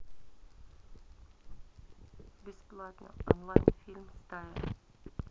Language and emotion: Russian, neutral